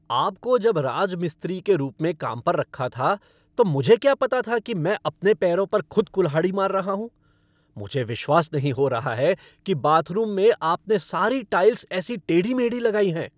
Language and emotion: Hindi, angry